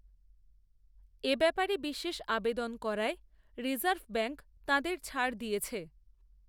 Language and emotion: Bengali, neutral